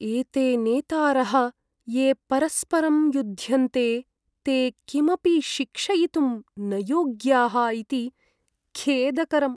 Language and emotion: Sanskrit, sad